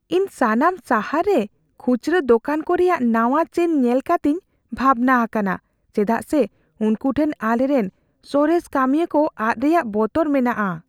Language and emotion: Santali, fearful